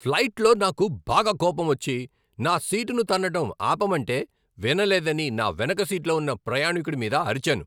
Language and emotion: Telugu, angry